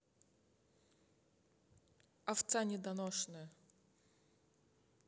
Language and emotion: Russian, angry